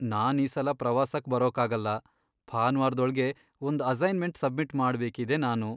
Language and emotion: Kannada, sad